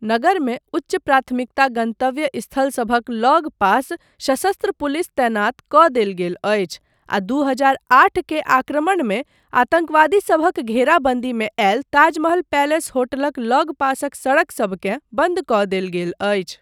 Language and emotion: Maithili, neutral